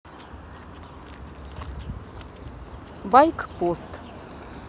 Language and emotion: Russian, neutral